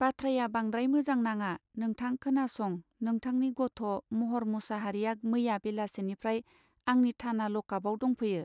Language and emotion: Bodo, neutral